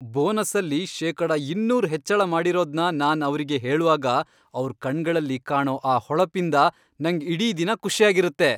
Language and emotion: Kannada, happy